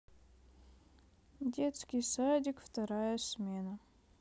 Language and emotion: Russian, sad